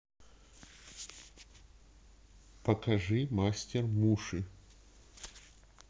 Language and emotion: Russian, neutral